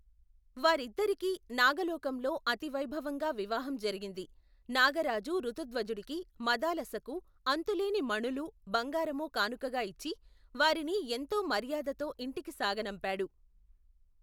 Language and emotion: Telugu, neutral